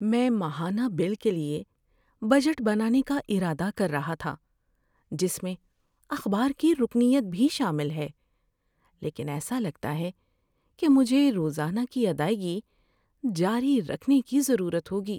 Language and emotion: Urdu, sad